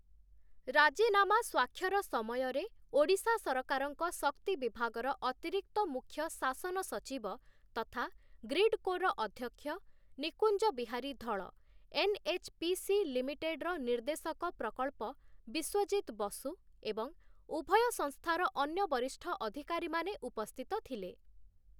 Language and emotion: Odia, neutral